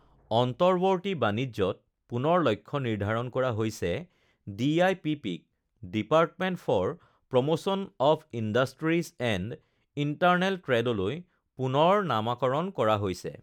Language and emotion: Assamese, neutral